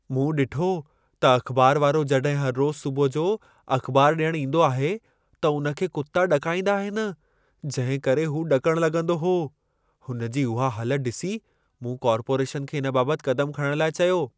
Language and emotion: Sindhi, fearful